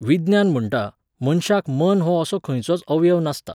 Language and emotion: Goan Konkani, neutral